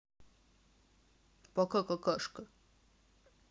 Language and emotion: Russian, neutral